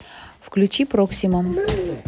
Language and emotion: Russian, neutral